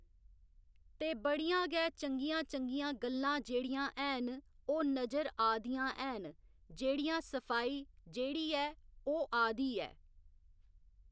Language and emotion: Dogri, neutral